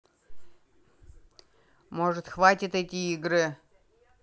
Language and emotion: Russian, angry